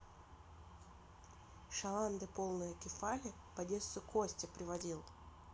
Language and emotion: Russian, neutral